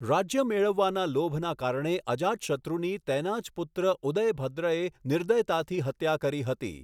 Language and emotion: Gujarati, neutral